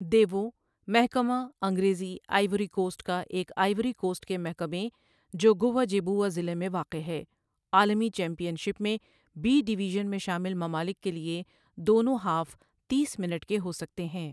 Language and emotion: Urdu, neutral